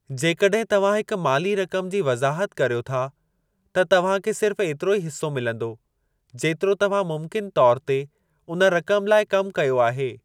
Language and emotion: Sindhi, neutral